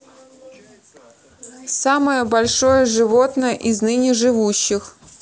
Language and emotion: Russian, neutral